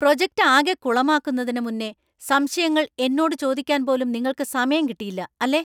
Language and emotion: Malayalam, angry